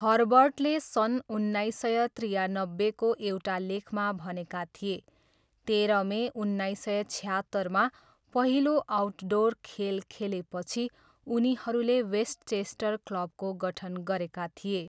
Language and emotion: Nepali, neutral